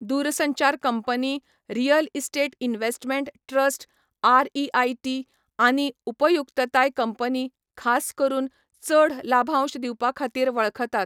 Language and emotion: Goan Konkani, neutral